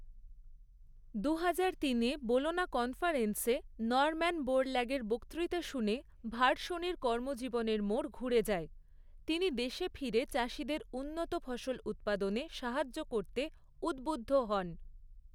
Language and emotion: Bengali, neutral